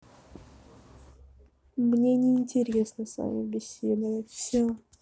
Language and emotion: Russian, sad